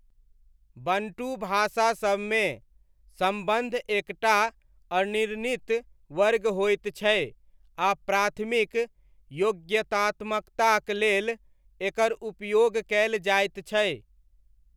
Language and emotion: Maithili, neutral